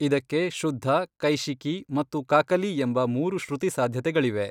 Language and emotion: Kannada, neutral